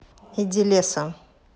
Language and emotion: Russian, angry